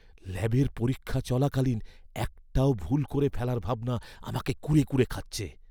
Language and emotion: Bengali, fearful